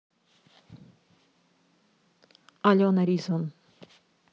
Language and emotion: Russian, neutral